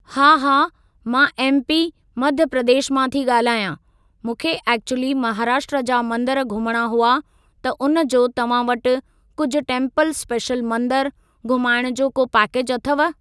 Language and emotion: Sindhi, neutral